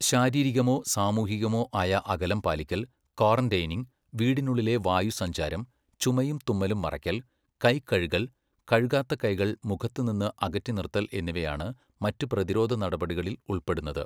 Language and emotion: Malayalam, neutral